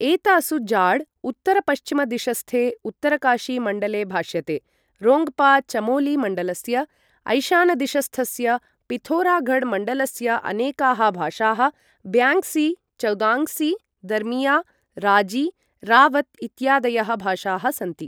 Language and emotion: Sanskrit, neutral